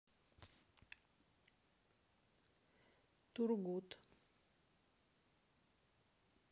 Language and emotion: Russian, neutral